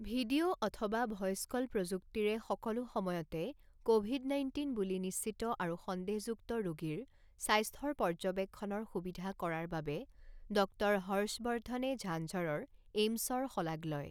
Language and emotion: Assamese, neutral